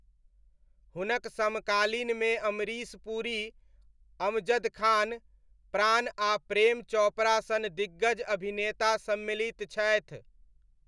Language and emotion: Maithili, neutral